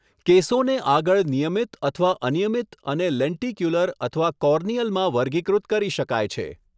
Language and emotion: Gujarati, neutral